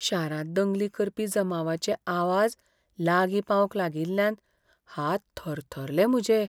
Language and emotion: Goan Konkani, fearful